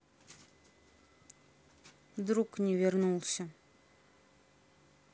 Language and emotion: Russian, sad